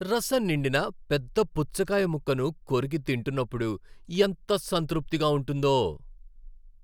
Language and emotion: Telugu, happy